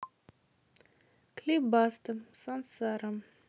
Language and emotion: Russian, neutral